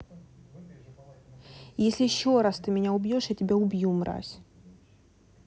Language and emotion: Russian, angry